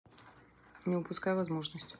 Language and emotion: Russian, neutral